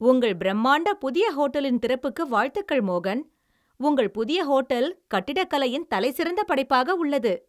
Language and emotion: Tamil, happy